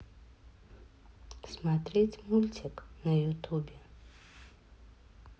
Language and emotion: Russian, neutral